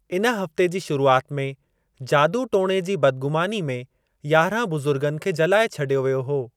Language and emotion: Sindhi, neutral